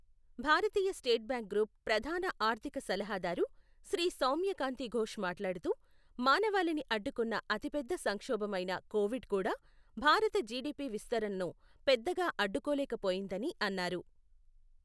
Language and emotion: Telugu, neutral